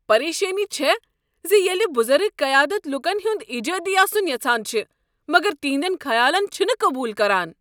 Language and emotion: Kashmiri, angry